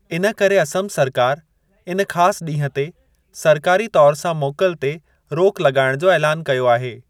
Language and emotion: Sindhi, neutral